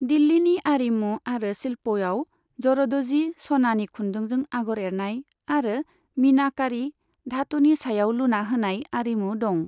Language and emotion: Bodo, neutral